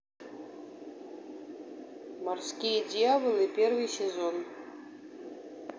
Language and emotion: Russian, neutral